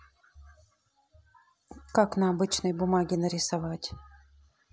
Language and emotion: Russian, neutral